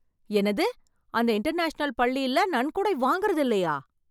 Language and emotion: Tamil, surprised